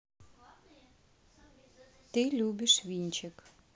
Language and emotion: Russian, neutral